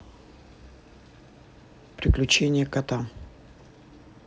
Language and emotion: Russian, neutral